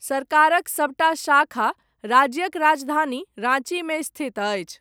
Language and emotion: Maithili, neutral